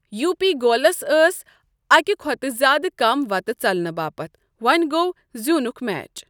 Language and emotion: Kashmiri, neutral